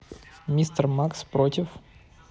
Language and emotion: Russian, neutral